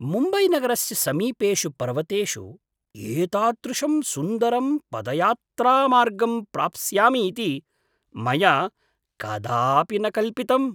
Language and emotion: Sanskrit, surprised